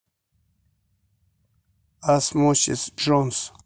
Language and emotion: Russian, neutral